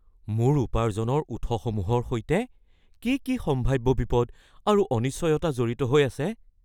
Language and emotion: Assamese, fearful